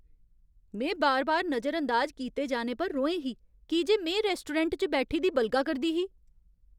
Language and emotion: Dogri, angry